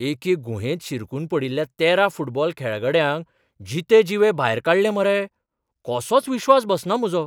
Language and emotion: Goan Konkani, surprised